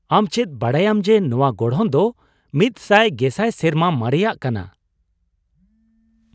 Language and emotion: Santali, surprised